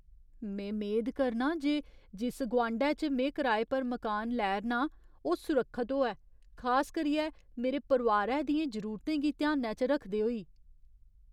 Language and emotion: Dogri, fearful